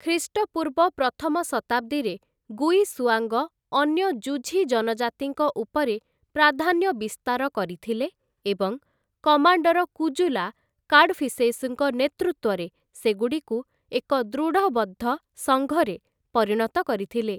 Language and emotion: Odia, neutral